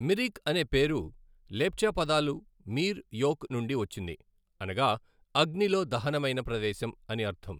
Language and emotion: Telugu, neutral